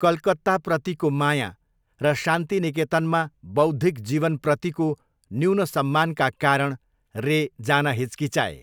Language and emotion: Nepali, neutral